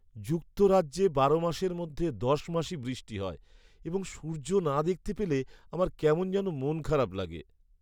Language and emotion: Bengali, sad